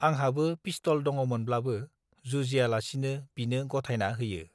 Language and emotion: Bodo, neutral